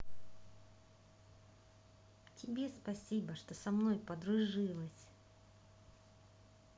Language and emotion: Russian, positive